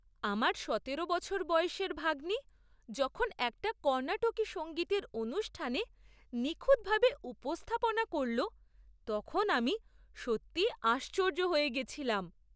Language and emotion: Bengali, surprised